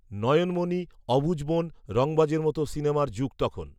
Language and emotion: Bengali, neutral